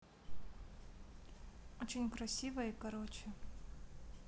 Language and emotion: Russian, neutral